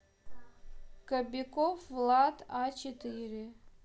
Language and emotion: Russian, neutral